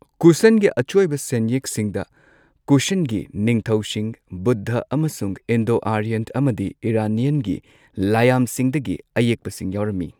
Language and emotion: Manipuri, neutral